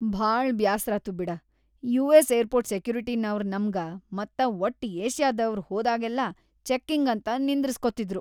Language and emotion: Kannada, disgusted